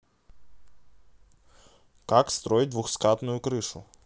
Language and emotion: Russian, neutral